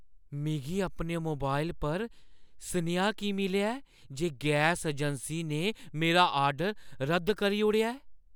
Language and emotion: Dogri, surprised